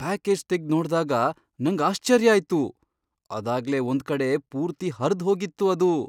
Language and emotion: Kannada, surprised